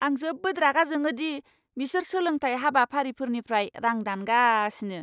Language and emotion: Bodo, angry